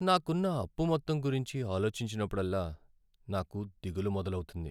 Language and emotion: Telugu, sad